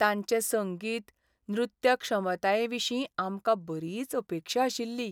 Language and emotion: Goan Konkani, sad